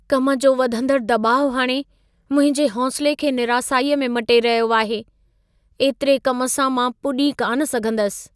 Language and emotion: Sindhi, sad